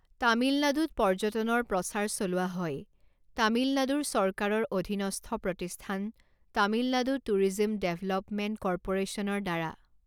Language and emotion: Assamese, neutral